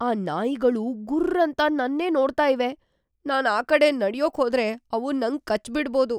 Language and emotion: Kannada, fearful